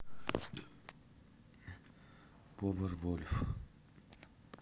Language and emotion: Russian, neutral